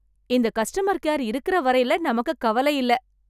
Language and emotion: Tamil, happy